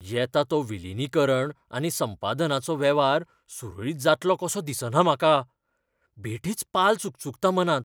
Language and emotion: Goan Konkani, fearful